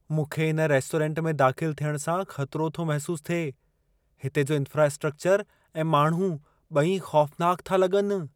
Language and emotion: Sindhi, fearful